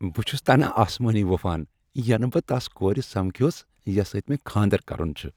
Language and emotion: Kashmiri, happy